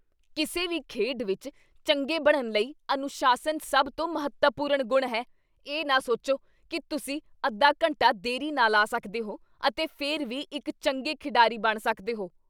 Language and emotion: Punjabi, angry